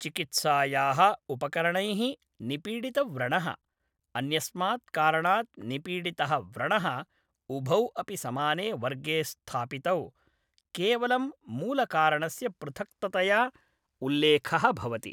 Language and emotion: Sanskrit, neutral